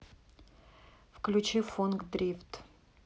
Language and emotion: Russian, neutral